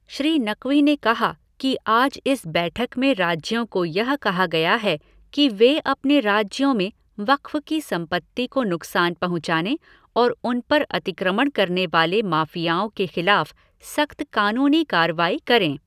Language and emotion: Hindi, neutral